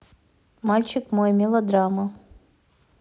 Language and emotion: Russian, neutral